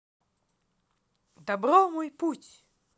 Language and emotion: Russian, positive